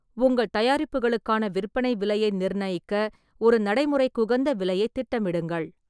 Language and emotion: Tamil, neutral